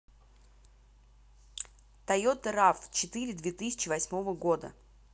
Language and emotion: Russian, neutral